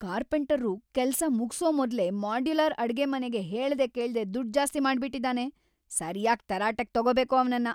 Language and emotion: Kannada, angry